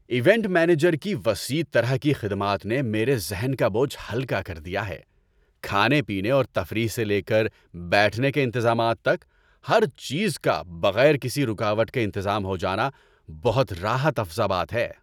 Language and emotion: Urdu, happy